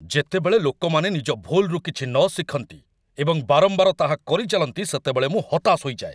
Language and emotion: Odia, angry